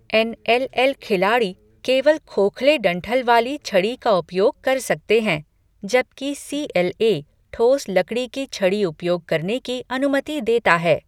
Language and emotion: Hindi, neutral